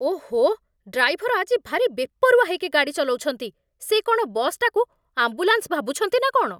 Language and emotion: Odia, angry